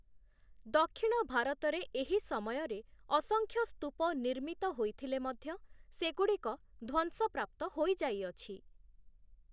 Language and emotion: Odia, neutral